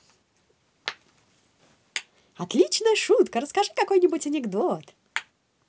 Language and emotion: Russian, positive